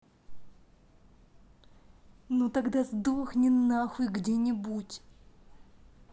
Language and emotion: Russian, angry